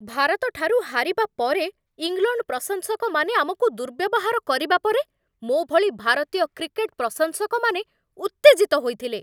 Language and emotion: Odia, angry